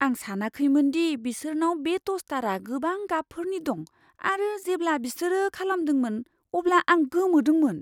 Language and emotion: Bodo, surprised